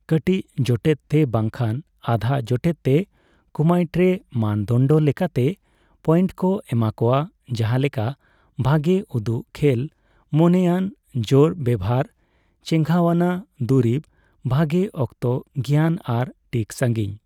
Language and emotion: Santali, neutral